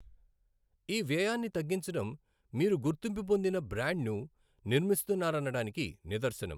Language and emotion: Telugu, neutral